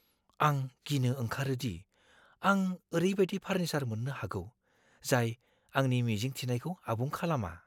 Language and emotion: Bodo, fearful